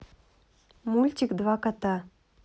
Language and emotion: Russian, neutral